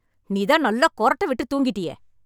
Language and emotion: Tamil, angry